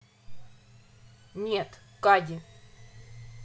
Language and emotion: Russian, angry